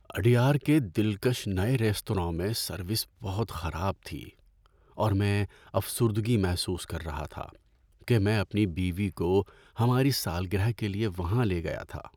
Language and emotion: Urdu, sad